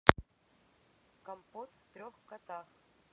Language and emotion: Russian, neutral